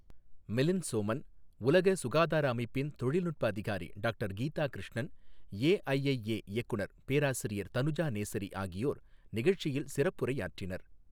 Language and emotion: Tamil, neutral